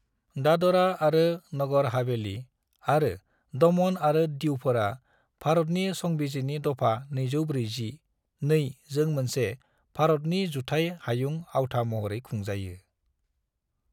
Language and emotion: Bodo, neutral